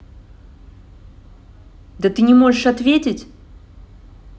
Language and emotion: Russian, angry